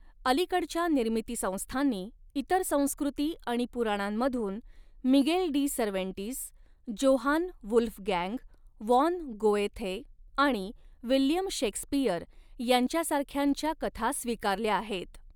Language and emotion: Marathi, neutral